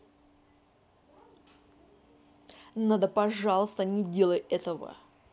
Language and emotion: Russian, angry